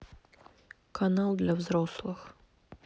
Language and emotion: Russian, neutral